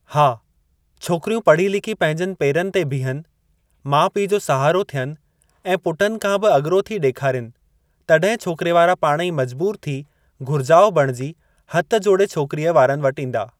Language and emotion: Sindhi, neutral